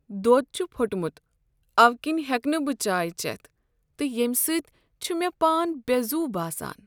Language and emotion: Kashmiri, sad